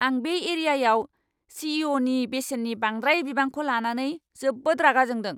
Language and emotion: Bodo, angry